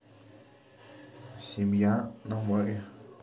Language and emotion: Russian, neutral